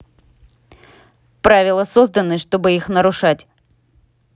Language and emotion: Russian, neutral